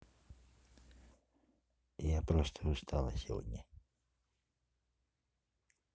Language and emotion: Russian, neutral